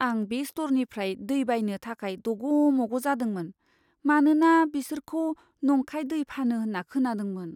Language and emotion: Bodo, fearful